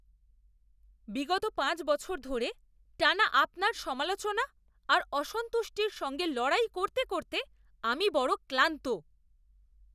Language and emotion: Bengali, disgusted